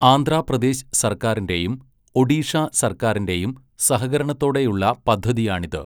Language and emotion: Malayalam, neutral